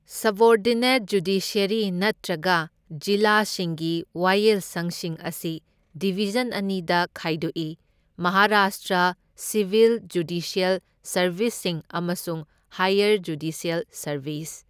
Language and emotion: Manipuri, neutral